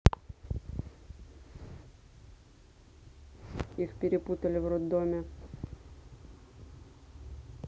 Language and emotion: Russian, neutral